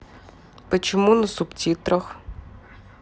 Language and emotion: Russian, neutral